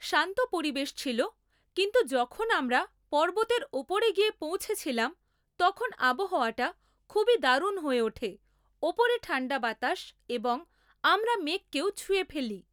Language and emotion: Bengali, neutral